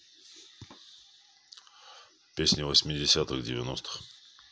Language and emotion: Russian, neutral